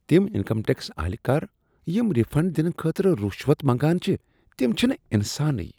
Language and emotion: Kashmiri, disgusted